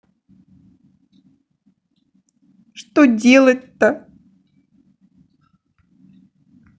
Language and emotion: Russian, sad